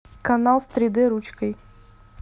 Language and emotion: Russian, neutral